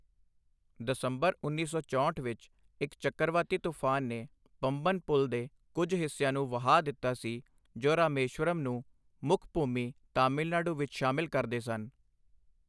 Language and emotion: Punjabi, neutral